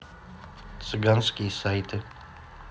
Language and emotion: Russian, neutral